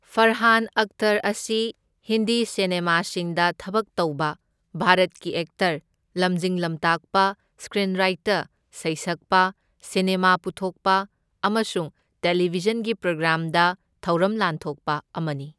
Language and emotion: Manipuri, neutral